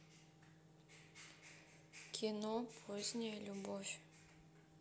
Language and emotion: Russian, neutral